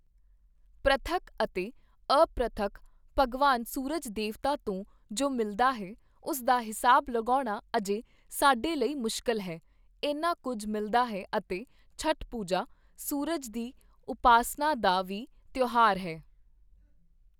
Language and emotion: Punjabi, neutral